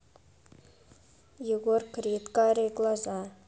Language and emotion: Russian, neutral